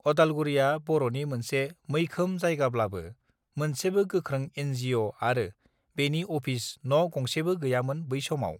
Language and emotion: Bodo, neutral